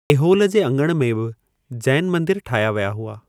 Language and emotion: Sindhi, neutral